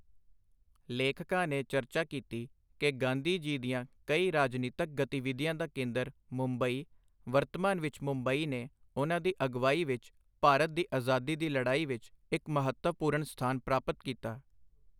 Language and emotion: Punjabi, neutral